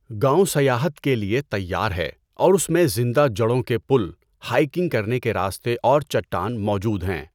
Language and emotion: Urdu, neutral